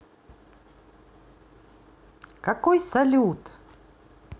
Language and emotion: Russian, positive